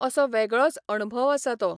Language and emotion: Goan Konkani, neutral